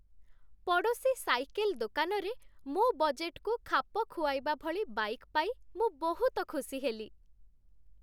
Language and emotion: Odia, happy